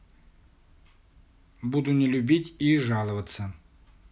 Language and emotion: Russian, neutral